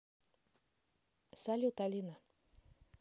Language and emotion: Russian, neutral